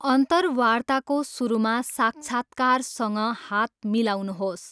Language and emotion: Nepali, neutral